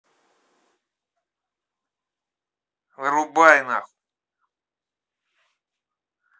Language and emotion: Russian, angry